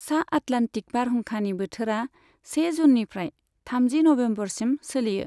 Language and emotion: Bodo, neutral